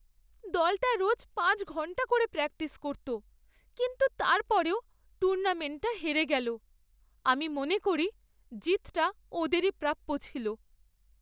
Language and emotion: Bengali, sad